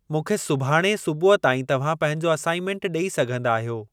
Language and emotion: Sindhi, neutral